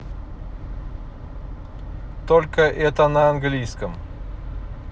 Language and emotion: Russian, neutral